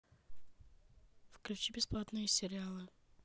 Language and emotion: Russian, neutral